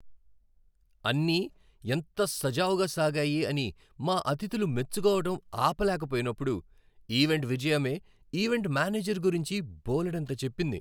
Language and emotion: Telugu, happy